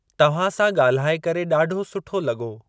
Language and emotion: Sindhi, neutral